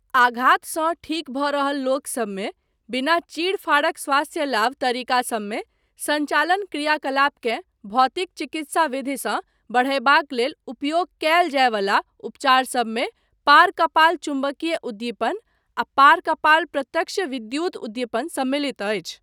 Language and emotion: Maithili, neutral